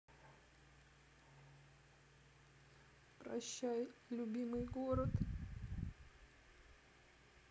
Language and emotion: Russian, sad